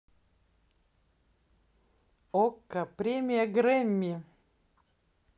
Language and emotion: Russian, positive